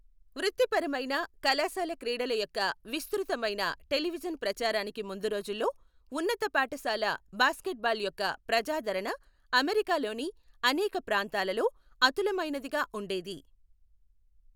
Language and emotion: Telugu, neutral